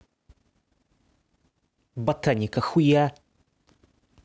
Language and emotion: Russian, angry